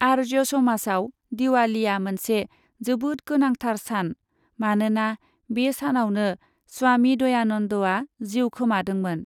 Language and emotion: Bodo, neutral